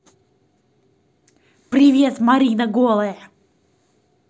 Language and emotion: Russian, angry